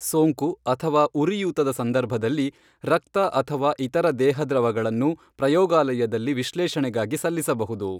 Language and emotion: Kannada, neutral